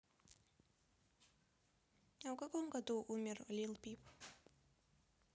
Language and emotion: Russian, neutral